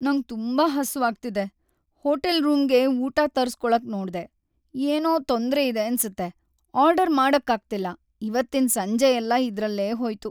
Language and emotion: Kannada, sad